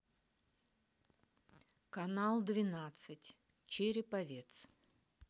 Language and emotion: Russian, neutral